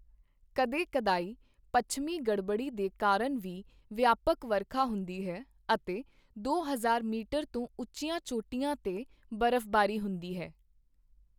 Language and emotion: Punjabi, neutral